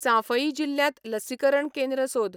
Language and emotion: Goan Konkani, neutral